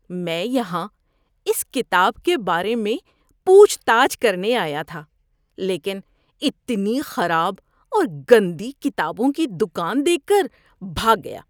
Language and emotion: Urdu, disgusted